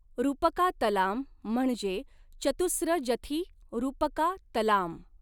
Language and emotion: Marathi, neutral